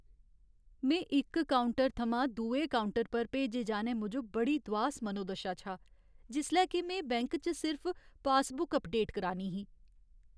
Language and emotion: Dogri, sad